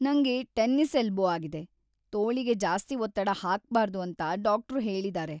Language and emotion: Kannada, sad